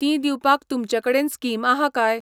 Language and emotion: Goan Konkani, neutral